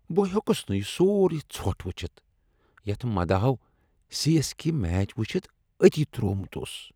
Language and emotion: Kashmiri, disgusted